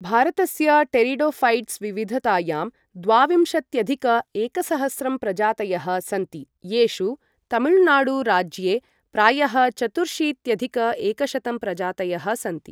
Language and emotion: Sanskrit, neutral